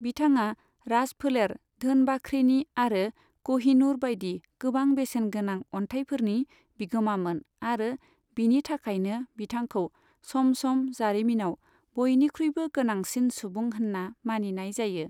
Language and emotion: Bodo, neutral